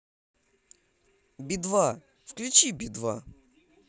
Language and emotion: Russian, positive